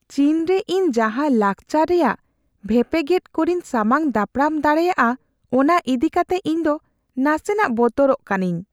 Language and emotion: Santali, fearful